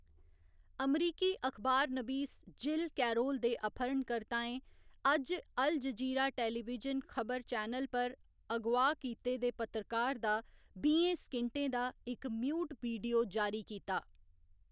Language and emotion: Dogri, neutral